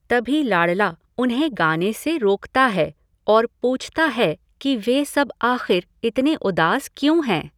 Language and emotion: Hindi, neutral